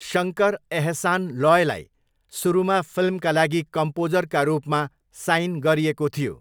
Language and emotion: Nepali, neutral